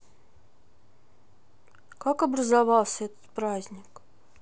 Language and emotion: Russian, sad